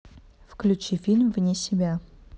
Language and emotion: Russian, neutral